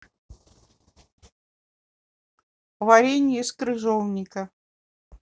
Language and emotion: Russian, neutral